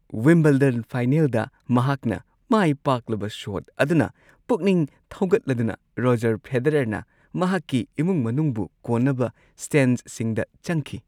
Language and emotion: Manipuri, happy